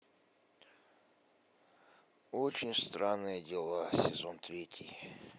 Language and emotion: Russian, sad